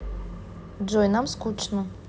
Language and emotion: Russian, neutral